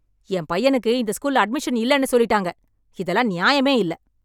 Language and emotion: Tamil, angry